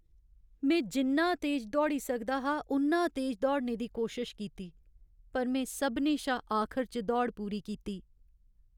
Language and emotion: Dogri, sad